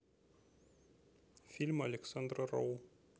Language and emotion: Russian, neutral